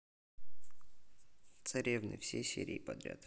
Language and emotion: Russian, neutral